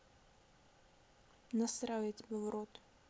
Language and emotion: Russian, neutral